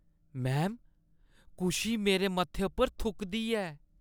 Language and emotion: Dogri, disgusted